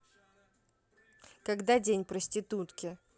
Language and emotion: Russian, neutral